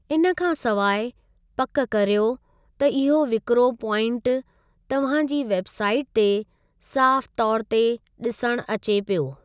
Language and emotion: Sindhi, neutral